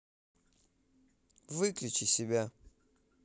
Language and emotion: Russian, neutral